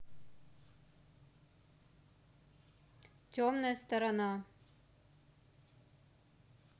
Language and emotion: Russian, neutral